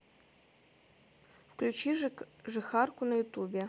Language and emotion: Russian, neutral